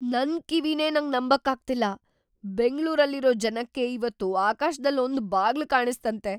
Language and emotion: Kannada, surprised